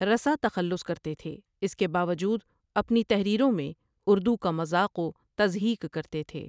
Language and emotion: Urdu, neutral